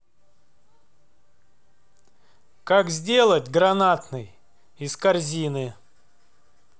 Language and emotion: Russian, neutral